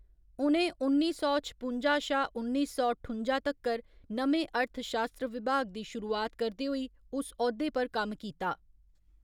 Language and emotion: Dogri, neutral